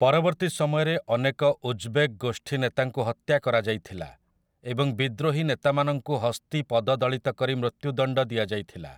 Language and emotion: Odia, neutral